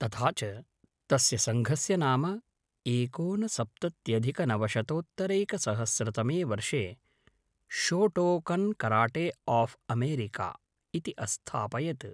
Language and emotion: Sanskrit, neutral